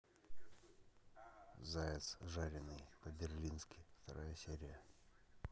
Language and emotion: Russian, neutral